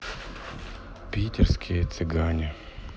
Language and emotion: Russian, sad